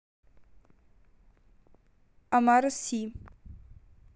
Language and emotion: Russian, neutral